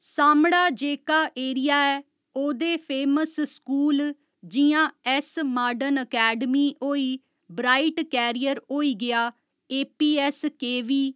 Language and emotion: Dogri, neutral